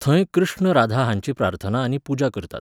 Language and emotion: Goan Konkani, neutral